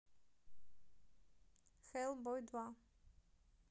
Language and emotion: Russian, neutral